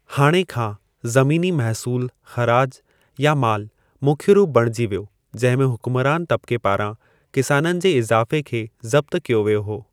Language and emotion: Sindhi, neutral